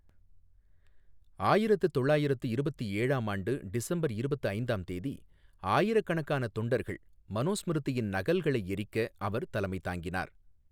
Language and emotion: Tamil, neutral